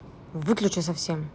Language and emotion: Russian, angry